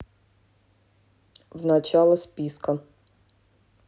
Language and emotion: Russian, neutral